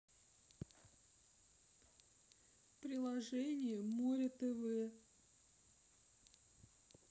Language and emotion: Russian, sad